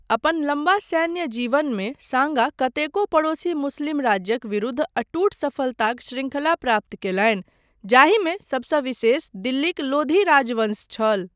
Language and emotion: Maithili, neutral